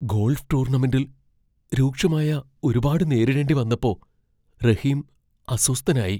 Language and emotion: Malayalam, fearful